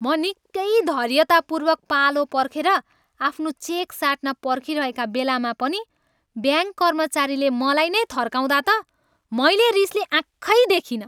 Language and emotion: Nepali, angry